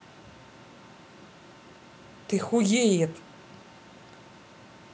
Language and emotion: Russian, angry